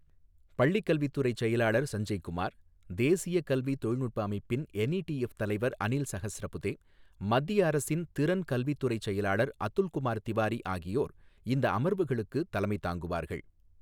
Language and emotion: Tamil, neutral